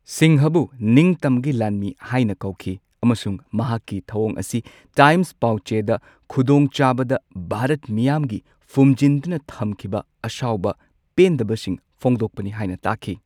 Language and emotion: Manipuri, neutral